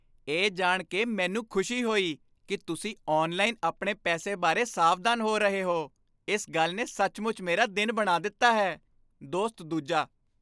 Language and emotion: Punjabi, happy